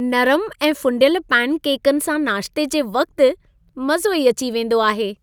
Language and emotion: Sindhi, happy